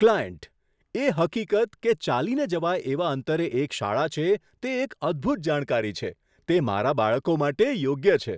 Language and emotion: Gujarati, surprised